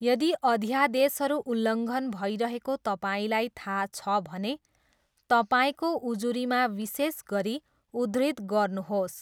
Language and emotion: Nepali, neutral